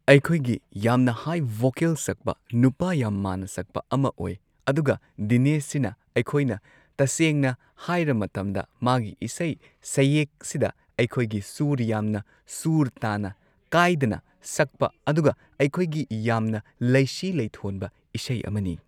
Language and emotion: Manipuri, neutral